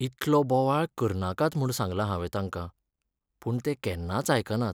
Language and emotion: Goan Konkani, sad